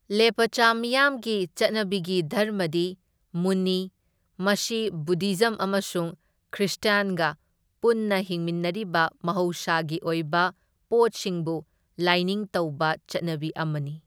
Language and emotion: Manipuri, neutral